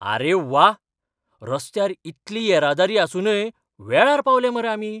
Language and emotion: Goan Konkani, surprised